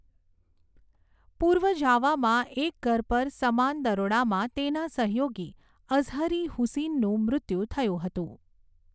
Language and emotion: Gujarati, neutral